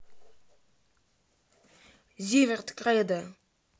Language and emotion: Russian, neutral